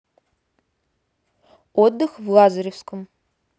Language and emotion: Russian, neutral